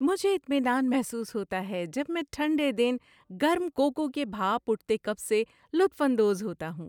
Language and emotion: Urdu, happy